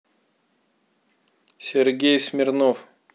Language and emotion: Russian, neutral